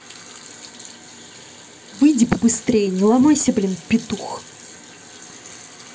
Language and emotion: Russian, angry